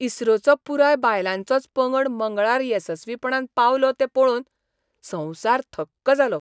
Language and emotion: Goan Konkani, surprised